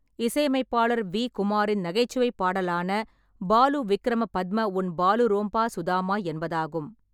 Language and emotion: Tamil, neutral